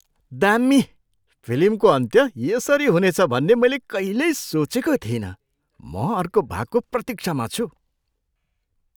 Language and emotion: Nepali, surprised